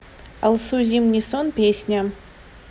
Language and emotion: Russian, neutral